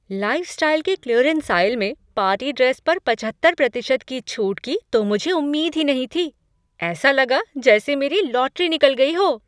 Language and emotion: Hindi, surprised